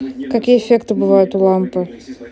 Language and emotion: Russian, neutral